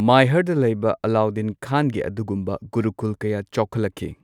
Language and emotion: Manipuri, neutral